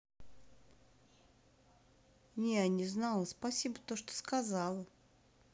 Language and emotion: Russian, neutral